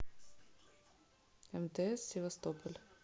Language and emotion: Russian, neutral